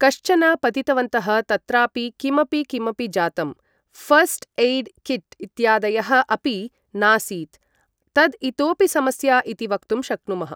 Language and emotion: Sanskrit, neutral